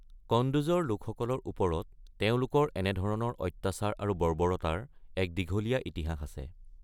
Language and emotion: Assamese, neutral